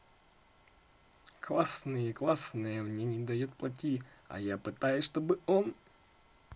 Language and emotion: Russian, positive